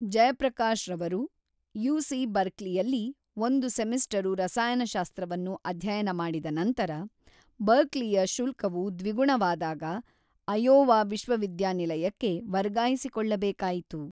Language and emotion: Kannada, neutral